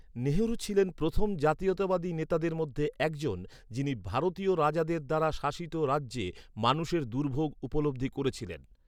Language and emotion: Bengali, neutral